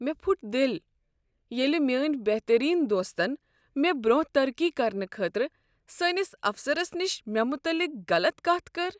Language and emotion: Kashmiri, sad